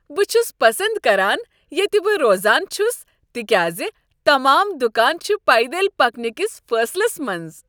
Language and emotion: Kashmiri, happy